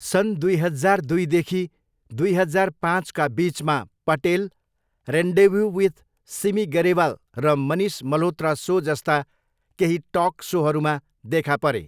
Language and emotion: Nepali, neutral